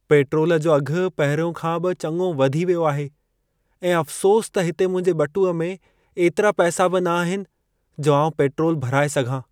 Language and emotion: Sindhi, sad